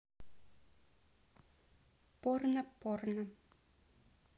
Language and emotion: Russian, neutral